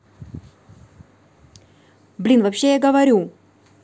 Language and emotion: Russian, angry